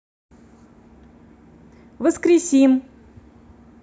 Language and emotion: Russian, positive